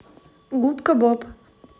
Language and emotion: Russian, neutral